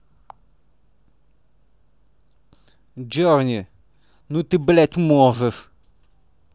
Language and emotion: Russian, angry